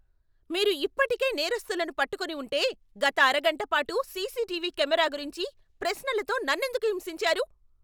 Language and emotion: Telugu, angry